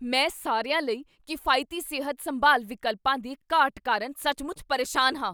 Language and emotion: Punjabi, angry